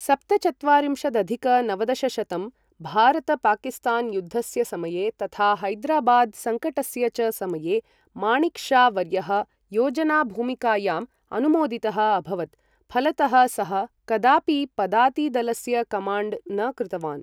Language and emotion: Sanskrit, neutral